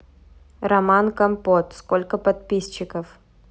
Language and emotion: Russian, neutral